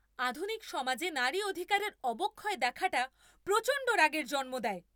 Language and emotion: Bengali, angry